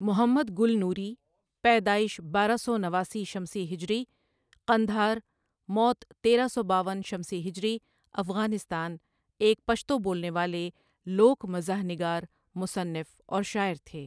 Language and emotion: Urdu, neutral